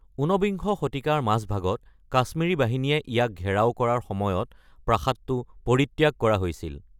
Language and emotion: Assamese, neutral